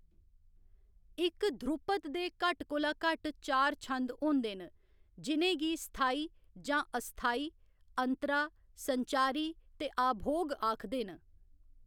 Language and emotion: Dogri, neutral